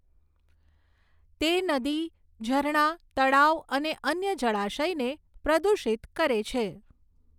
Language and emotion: Gujarati, neutral